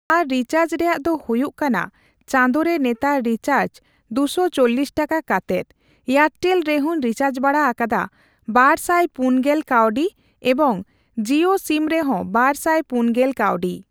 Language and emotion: Santali, neutral